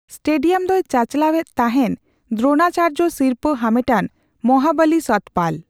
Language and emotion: Santali, neutral